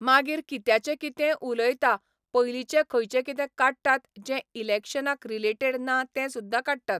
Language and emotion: Goan Konkani, neutral